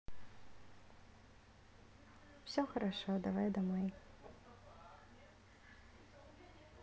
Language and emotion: Russian, neutral